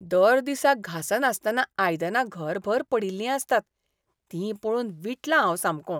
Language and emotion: Goan Konkani, disgusted